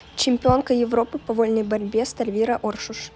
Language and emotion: Russian, neutral